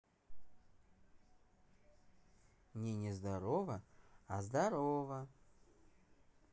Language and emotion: Russian, positive